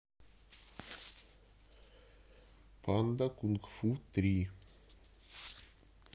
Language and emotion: Russian, neutral